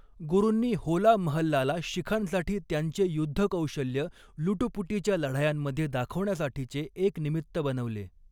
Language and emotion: Marathi, neutral